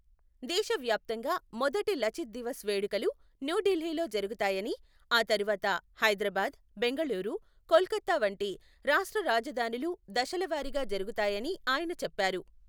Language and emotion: Telugu, neutral